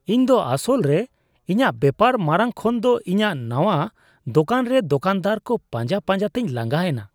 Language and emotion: Santali, disgusted